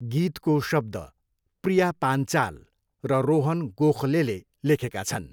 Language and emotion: Nepali, neutral